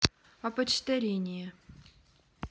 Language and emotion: Russian, neutral